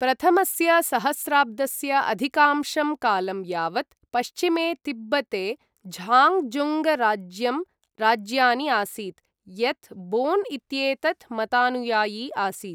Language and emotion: Sanskrit, neutral